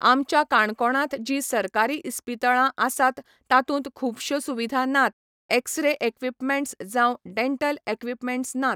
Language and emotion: Goan Konkani, neutral